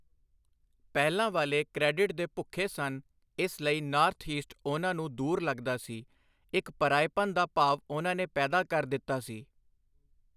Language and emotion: Punjabi, neutral